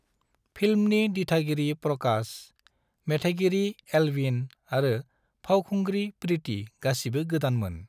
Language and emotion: Bodo, neutral